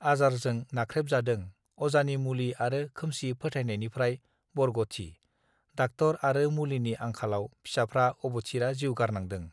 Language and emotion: Bodo, neutral